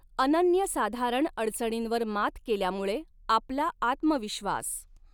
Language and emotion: Marathi, neutral